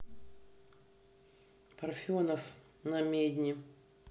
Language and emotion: Russian, neutral